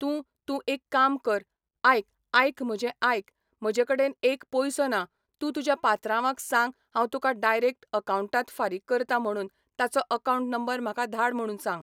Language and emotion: Goan Konkani, neutral